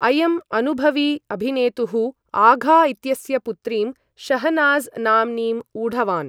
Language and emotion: Sanskrit, neutral